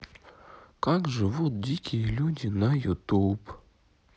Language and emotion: Russian, sad